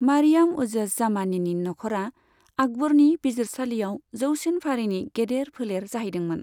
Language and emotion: Bodo, neutral